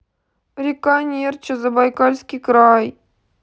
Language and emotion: Russian, sad